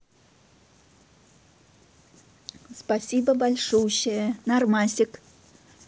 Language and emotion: Russian, positive